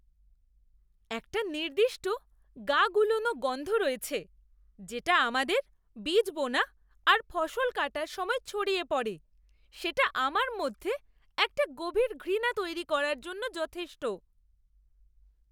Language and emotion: Bengali, disgusted